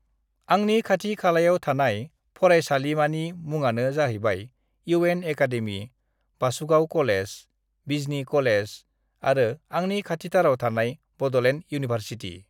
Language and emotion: Bodo, neutral